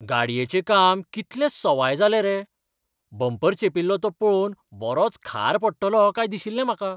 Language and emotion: Goan Konkani, surprised